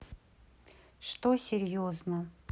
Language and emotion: Russian, sad